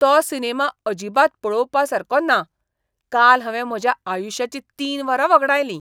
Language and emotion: Goan Konkani, disgusted